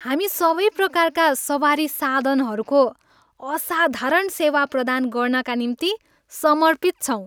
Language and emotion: Nepali, happy